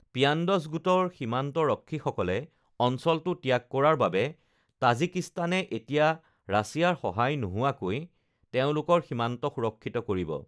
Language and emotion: Assamese, neutral